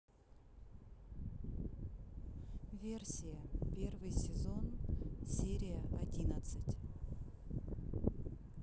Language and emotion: Russian, neutral